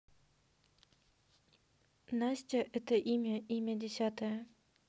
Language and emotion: Russian, neutral